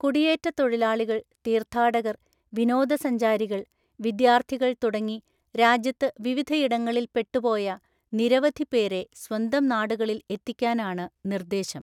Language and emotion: Malayalam, neutral